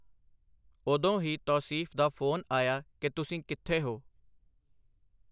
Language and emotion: Punjabi, neutral